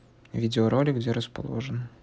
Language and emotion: Russian, neutral